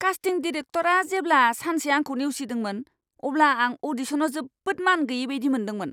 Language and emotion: Bodo, angry